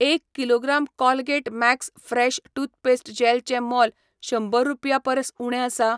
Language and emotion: Goan Konkani, neutral